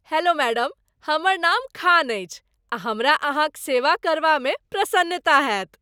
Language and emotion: Maithili, happy